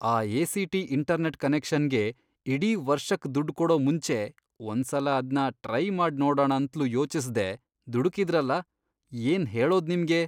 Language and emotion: Kannada, disgusted